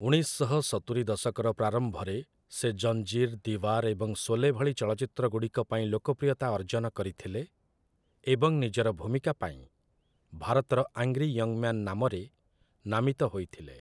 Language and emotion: Odia, neutral